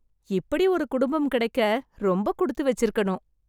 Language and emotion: Tamil, happy